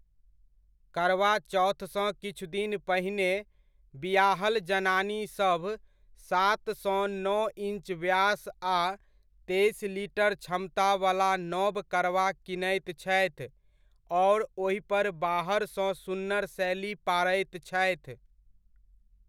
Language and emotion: Maithili, neutral